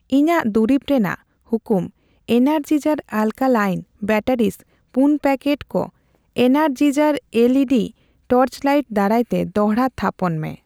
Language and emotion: Santali, neutral